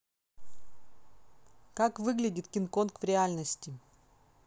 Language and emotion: Russian, neutral